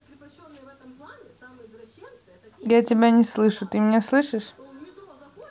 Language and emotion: Russian, neutral